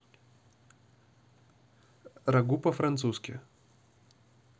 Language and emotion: Russian, neutral